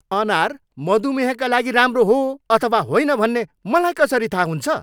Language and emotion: Nepali, angry